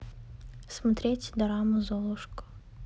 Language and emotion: Russian, neutral